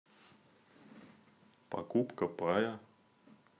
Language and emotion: Russian, neutral